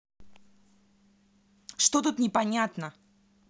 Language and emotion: Russian, angry